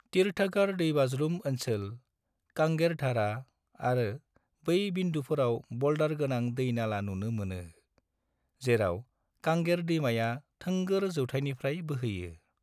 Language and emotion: Bodo, neutral